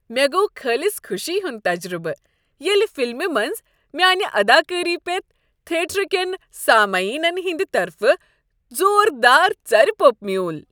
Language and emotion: Kashmiri, happy